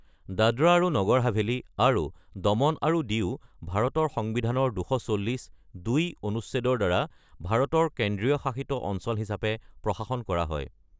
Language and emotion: Assamese, neutral